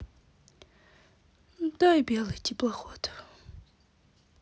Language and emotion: Russian, sad